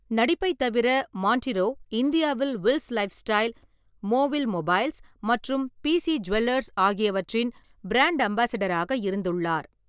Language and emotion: Tamil, neutral